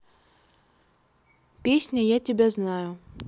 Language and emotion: Russian, neutral